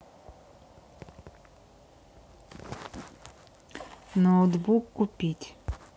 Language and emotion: Russian, neutral